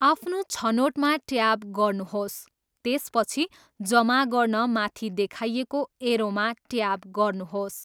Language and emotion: Nepali, neutral